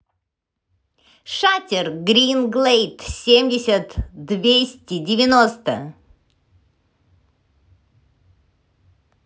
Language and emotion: Russian, neutral